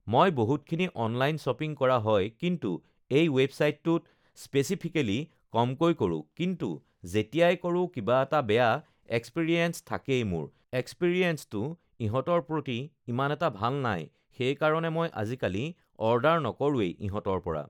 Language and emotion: Assamese, neutral